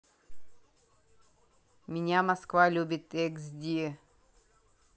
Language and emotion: Russian, neutral